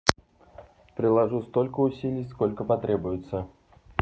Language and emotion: Russian, neutral